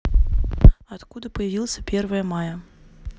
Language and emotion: Russian, neutral